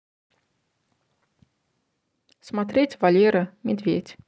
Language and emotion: Russian, neutral